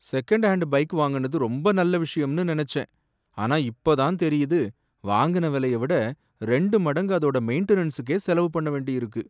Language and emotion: Tamil, sad